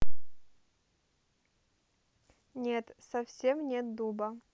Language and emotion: Russian, neutral